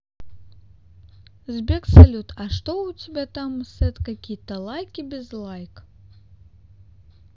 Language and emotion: Russian, neutral